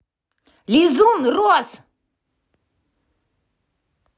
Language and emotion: Russian, angry